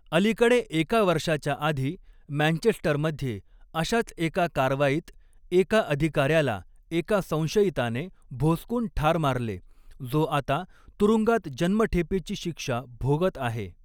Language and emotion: Marathi, neutral